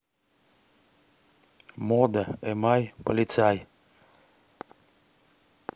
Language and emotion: Russian, neutral